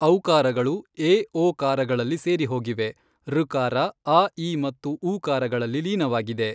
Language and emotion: Kannada, neutral